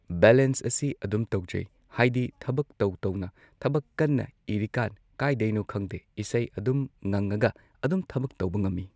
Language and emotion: Manipuri, neutral